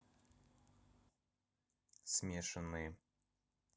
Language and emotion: Russian, neutral